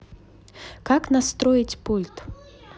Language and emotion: Russian, neutral